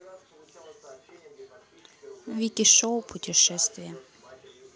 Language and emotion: Russian, neutral